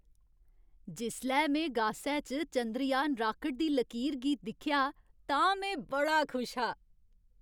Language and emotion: Dogri, happy